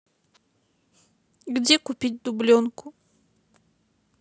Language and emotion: Russian, sad